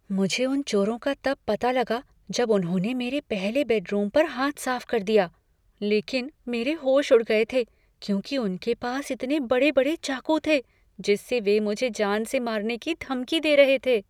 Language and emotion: Hindi, fearful